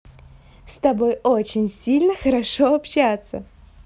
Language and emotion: Russian, positive